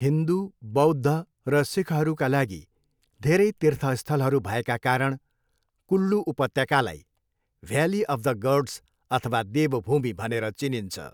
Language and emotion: Nepali, neutral